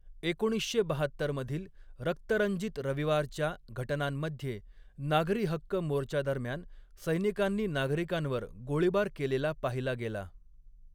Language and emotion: Marathi, neutral